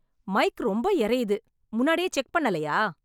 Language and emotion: Tamil, angry